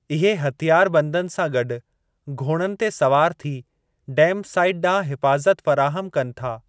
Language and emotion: Sindhi, neutral